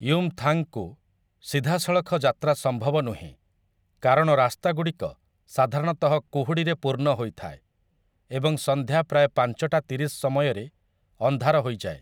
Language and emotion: Odia, neutral